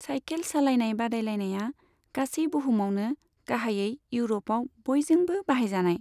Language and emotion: Bodo, neutral